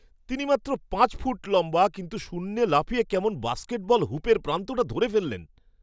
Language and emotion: Bengali, surprised